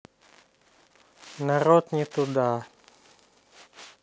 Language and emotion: Russian, neutral